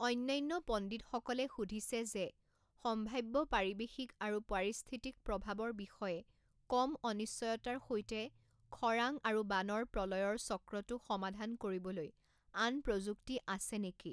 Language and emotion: Assamese, neutral